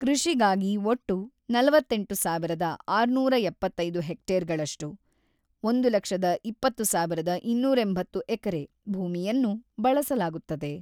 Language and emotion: Kannada, neutral